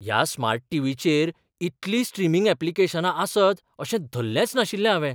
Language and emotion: Goan Konkani, surprised